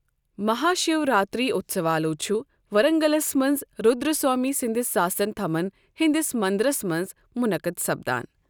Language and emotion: Kashmiri, neutral